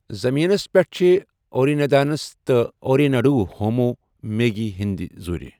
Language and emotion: Kashmiri, neutral